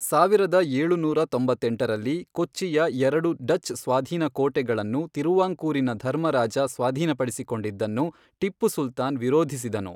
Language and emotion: Kannada, neutral